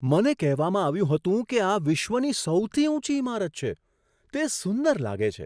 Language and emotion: Gujarati, surprised